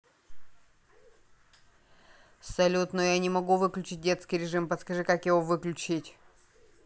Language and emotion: Russian, neutral